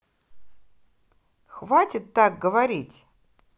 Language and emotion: Russian, angry